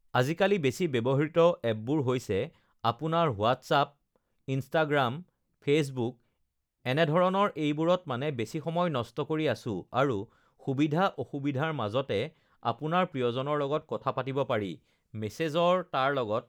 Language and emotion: Assamese, neutral